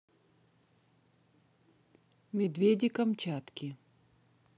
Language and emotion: Russian, neutral